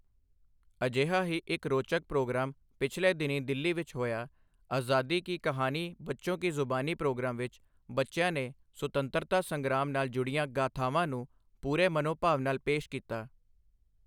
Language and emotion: Punjabi, neutral